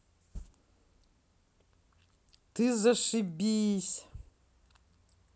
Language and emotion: Russian, positive